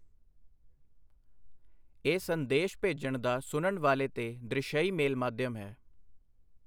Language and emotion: Punjabi, neutral